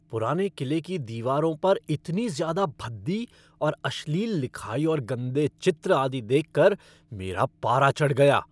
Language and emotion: Hindi, angry